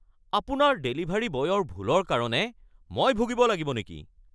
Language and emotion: Assamese, angry